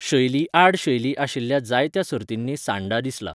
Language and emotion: Goan Konkani, neutral